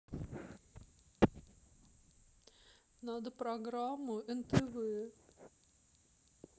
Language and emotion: Russian, sad